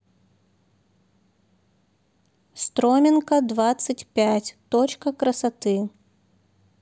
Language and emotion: Russian, neutral